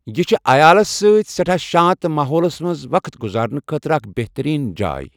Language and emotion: Kashmiri, neutral